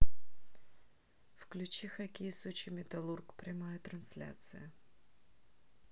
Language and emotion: Russian, neutral